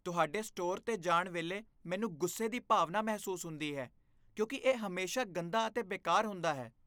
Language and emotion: Punjabi, disgusted